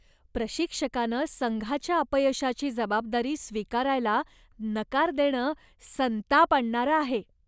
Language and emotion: Marathi, disgusted